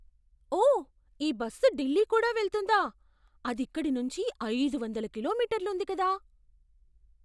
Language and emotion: Telugu, surprised